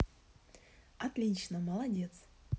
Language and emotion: Russian, positive